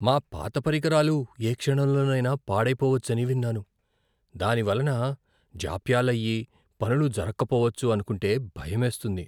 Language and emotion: Telugu, fearful